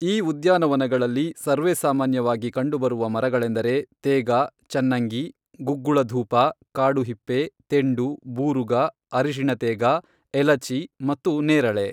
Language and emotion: Kannada, neutral